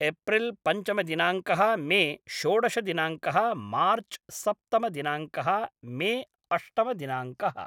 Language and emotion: Sanskrit, neutral